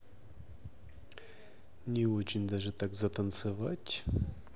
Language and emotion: Russian, neutral